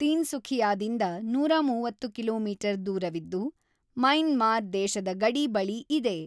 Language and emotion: Kannada, neutral